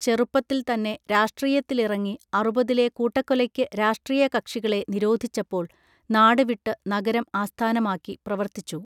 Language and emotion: Malayalam, neutral